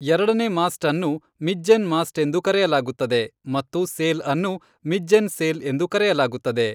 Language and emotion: Kannada, neutral